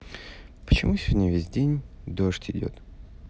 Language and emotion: Russian, sad